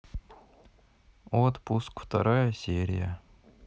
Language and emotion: Russian, sad